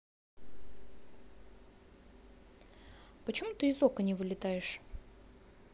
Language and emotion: Russian, neutral